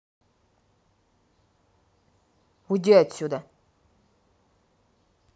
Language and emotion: Russian, angry